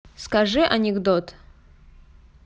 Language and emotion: Russian, neutral